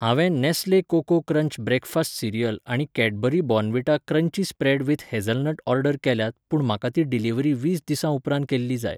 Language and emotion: Goan Konkani, neutral